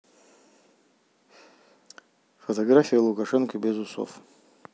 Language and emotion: Russian, neutral